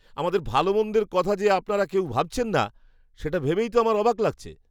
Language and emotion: Bengali, surprised